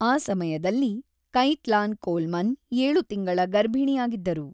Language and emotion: Kannada, neutral